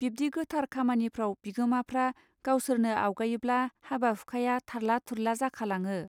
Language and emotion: Bodo, neutral